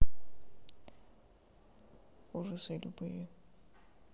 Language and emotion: Russian, sad